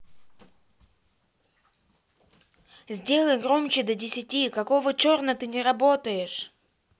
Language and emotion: Russian, angry